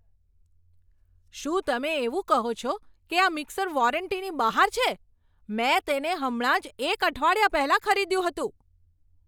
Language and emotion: Gujarati, angry